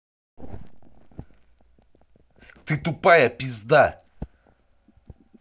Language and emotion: Russian, angry